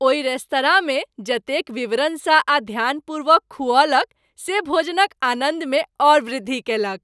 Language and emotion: Maithili, happy